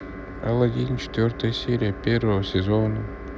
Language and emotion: Russian, sad